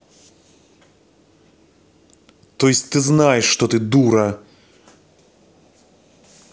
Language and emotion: Russian, angry